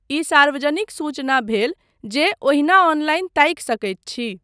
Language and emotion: Maithili, neutral